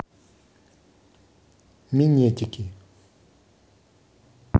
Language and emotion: Russian, neutral